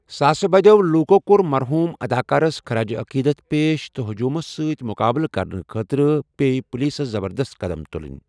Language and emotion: Kashmiri, neutral